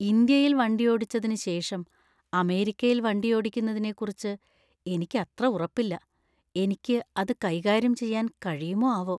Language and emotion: Malayalam, fearful